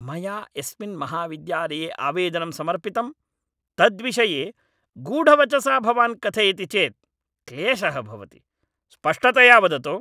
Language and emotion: Sanskrit, angry